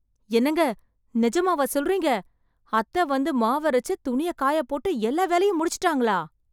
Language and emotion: Tamil, surprised